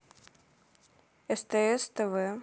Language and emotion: Russian, neutral